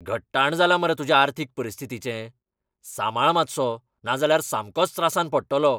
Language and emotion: Goan Konkani, angry